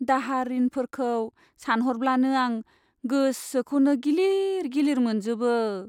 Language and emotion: Bodo, sad